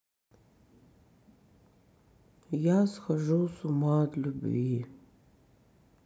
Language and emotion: Russian, sad